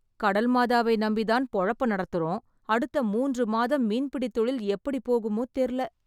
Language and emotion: Tamil, sad